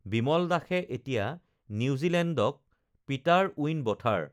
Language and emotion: Assamese, neutral